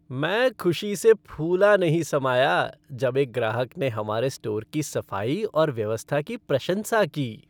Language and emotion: Hindi, happy